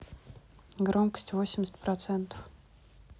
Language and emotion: Russian, neutral